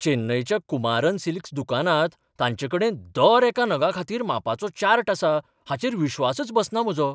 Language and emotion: Goan Konkani, surprised